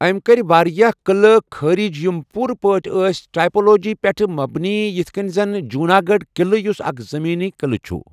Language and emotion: Kashmiri, neutral